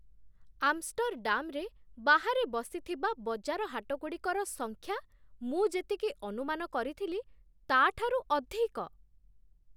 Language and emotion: Odia, surprised